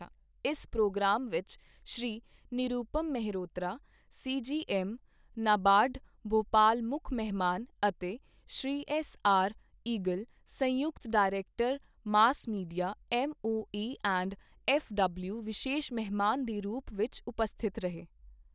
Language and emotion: Punjabi, neutral